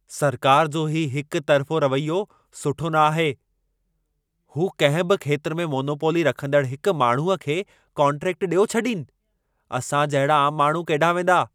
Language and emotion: Sindhi, angry